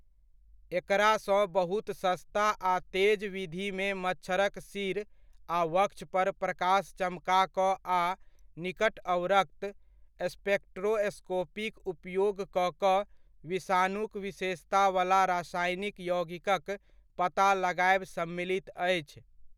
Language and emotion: Maithili, neutral